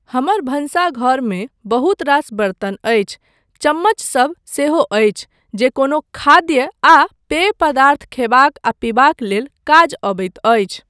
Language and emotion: Maithili, neutral